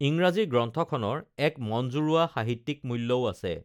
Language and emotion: Assamese, neutral